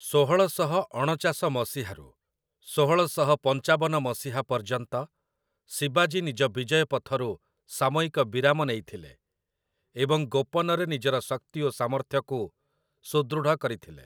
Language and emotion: Odia, neutral